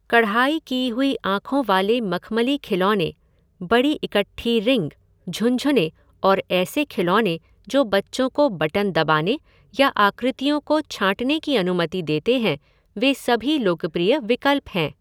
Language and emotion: Hindi, neutral